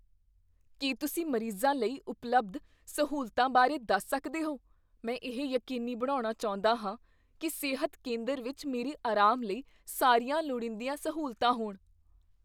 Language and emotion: Punjabi, fearful